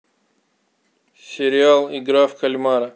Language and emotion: Russian, neutral